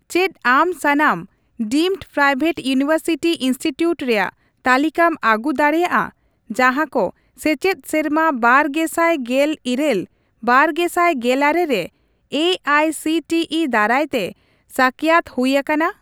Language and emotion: Santali, neutral